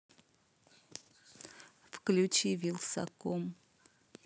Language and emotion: Russian, neutral